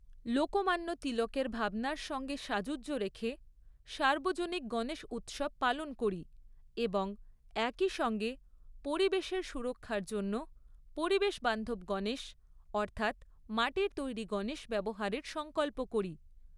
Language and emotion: Bengali, neutral